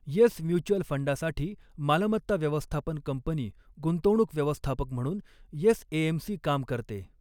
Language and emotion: Marathi, neutral